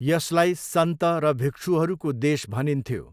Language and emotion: Nepali, neutral